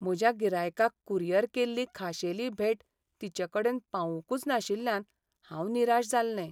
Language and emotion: Goan Konkani, sad